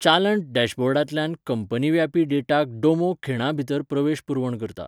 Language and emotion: Goan Konkani, neutral